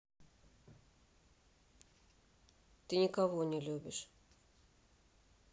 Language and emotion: Russian, sad